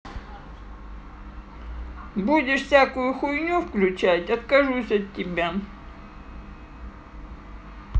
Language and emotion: Russian, angry